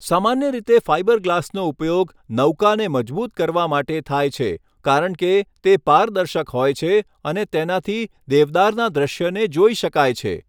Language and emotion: Gujarati, neutral